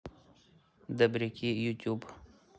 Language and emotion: Russian, neutral